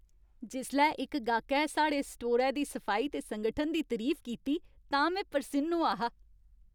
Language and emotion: Dogri, happy